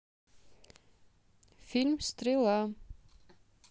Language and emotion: Russian, neutral